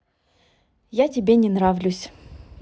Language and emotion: Russian, neutral